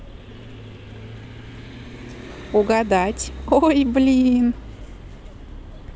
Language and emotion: Russian, positive